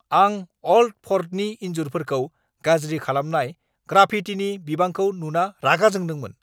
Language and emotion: Bodo, angry